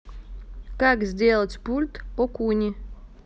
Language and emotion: Russian, neutral